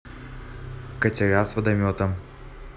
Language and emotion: Russian, neutral